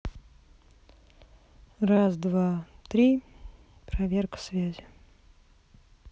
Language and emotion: Russian, neutral